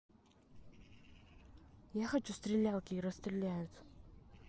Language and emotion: Russian, neutral